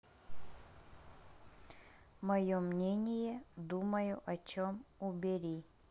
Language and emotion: Russian, neutral